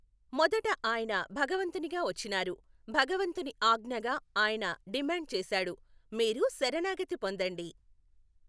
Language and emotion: Telugu, neutral